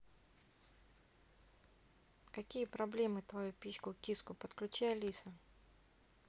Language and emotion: Russian, neutral